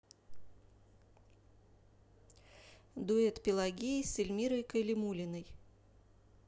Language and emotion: Russian, neutral